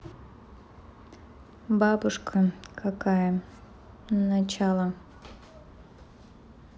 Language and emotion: Russian, neutral